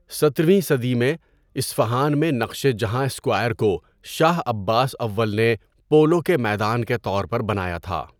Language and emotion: Urdu, neutral